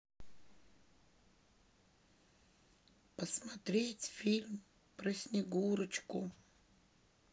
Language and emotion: Russian, sad